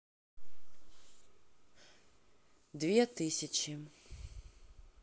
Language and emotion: Russian, neutral